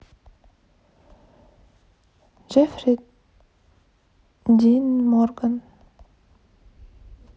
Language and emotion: Russian, neutral